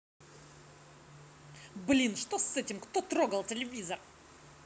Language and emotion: Russian, angry